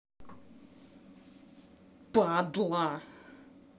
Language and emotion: Russian, angry